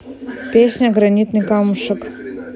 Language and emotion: Russian, neutral